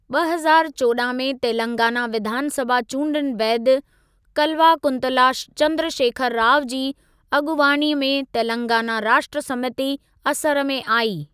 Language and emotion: Sindhi, neutral